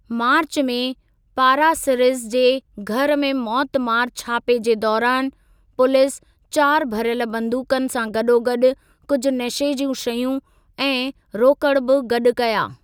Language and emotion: Sindhi, neutral